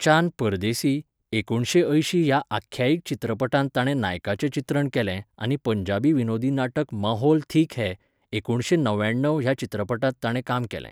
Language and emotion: Goan Konkani, neutral